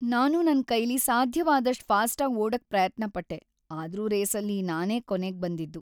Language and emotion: Kannada, sad